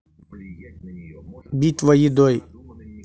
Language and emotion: Russian, neutral